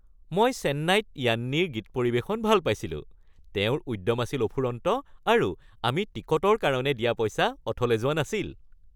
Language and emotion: Assamese, happy